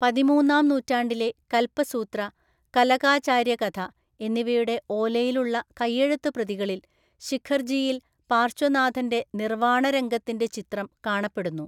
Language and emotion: Malayalam, neutral